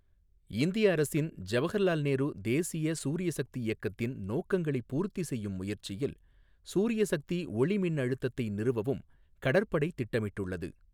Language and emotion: Tamil, neutral